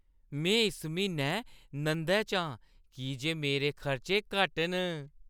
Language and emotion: Dogri, happy